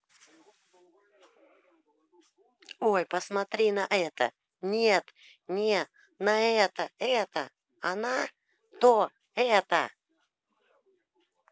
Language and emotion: Russian, angry